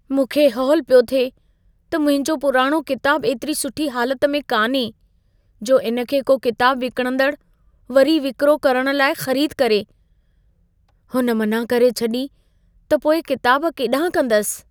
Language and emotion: Sindhi, fearful